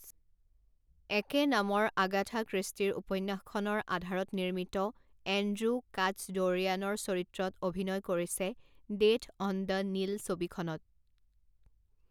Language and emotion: Assamese, neutral